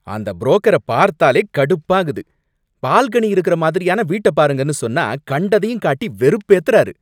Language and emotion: Tamil, angry